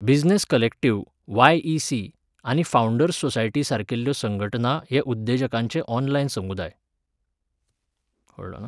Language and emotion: Goan Konkani, neutral